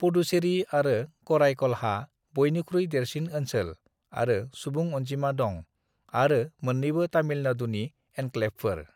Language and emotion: Bodo, neutral